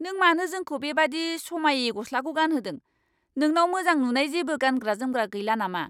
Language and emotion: Bodo, angry